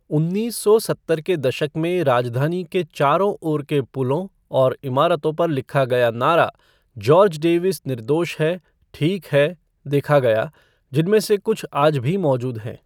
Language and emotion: Hindi, neutral